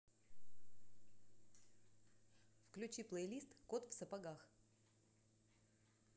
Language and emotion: Russian, neutral